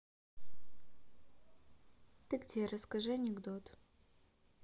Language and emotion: Russian, neutral